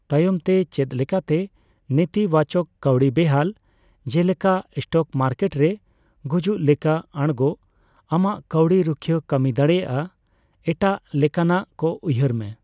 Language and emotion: Santali, neutral